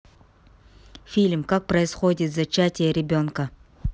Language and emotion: Russian, neutral